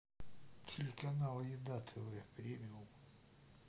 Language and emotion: Russian, neutral